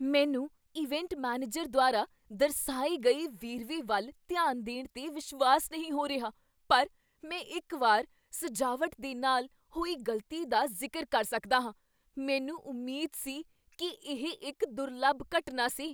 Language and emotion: Punjabi, surprised